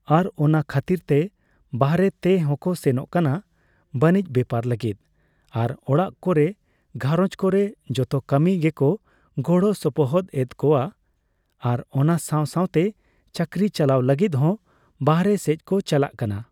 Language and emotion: Santali, neutral